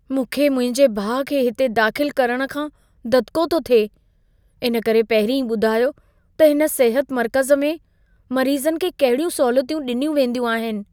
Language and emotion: Sindhi, fearful